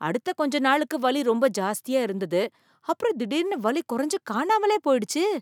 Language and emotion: Tamil, surprised